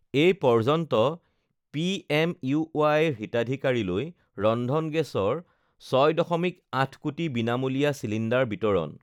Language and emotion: Assamese, neutral